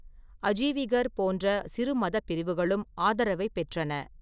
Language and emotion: Tamil, neutral